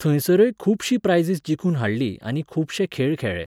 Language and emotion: Goan Konkani, neutral